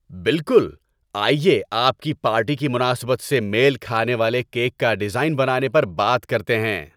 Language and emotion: Urdu, happy